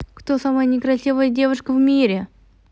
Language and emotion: Russian, positive